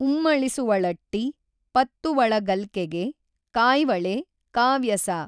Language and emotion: Kannada, neutral